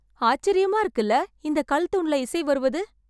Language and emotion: Tamil, surprised